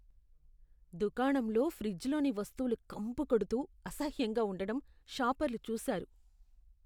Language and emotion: Telugu, disgusted